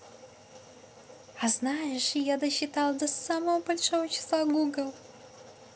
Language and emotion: Russian, positive